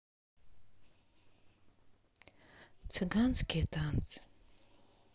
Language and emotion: Russian, sad